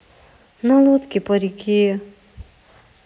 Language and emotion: Russian, sad